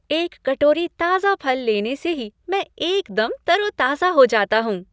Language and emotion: Hindi, happy